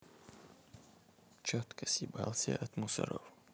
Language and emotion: Russian, neutral